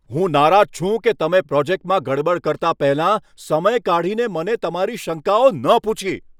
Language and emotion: Gujarati, angry